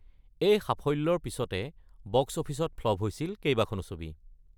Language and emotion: Assamese, neutral